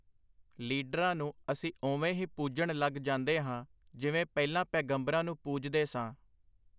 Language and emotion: Punjabi, neutral